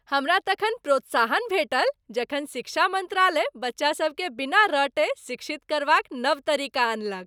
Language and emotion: Maithili, happy